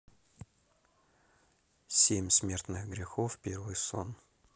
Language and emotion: Russian, neutral